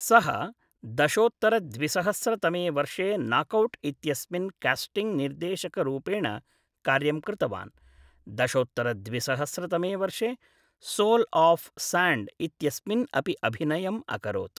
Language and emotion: Sanskrit, neutral